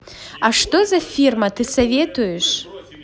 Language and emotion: Russian, positive